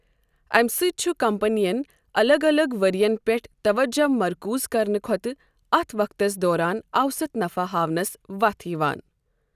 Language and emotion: Kashmiri, neutral